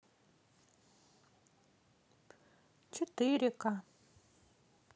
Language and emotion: Russian, neutral